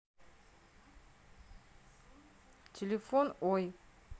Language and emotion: Russian, neutral